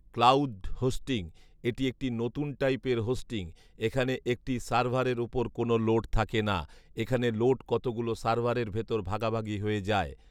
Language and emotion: Bengali, neutral